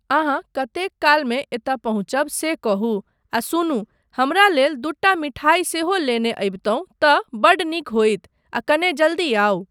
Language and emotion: Maithili, neutral